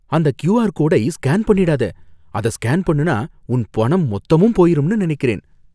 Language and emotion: Tamil, fearful